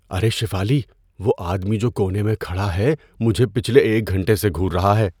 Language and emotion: Urdu, fearful